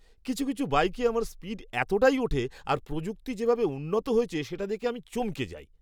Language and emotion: Bengali, surprised